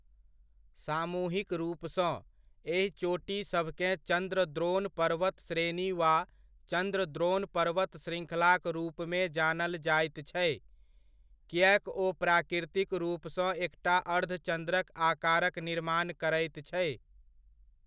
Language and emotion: Maithili, neutral